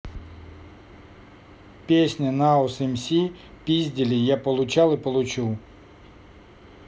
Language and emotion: Russian, neutral